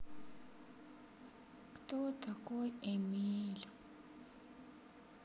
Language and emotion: Russian, sad